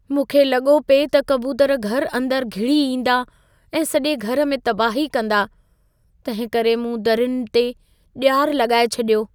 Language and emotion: Sindhi, fearful